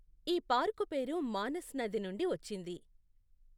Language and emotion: Telugu, neutral